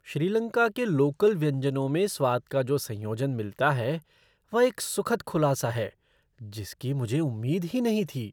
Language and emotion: Hindi, surprised